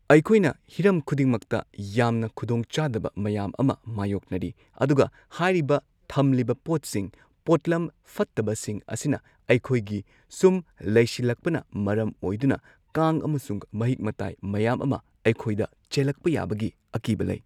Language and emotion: Manipuri, neutral